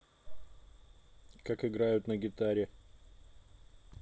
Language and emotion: Russian, neutral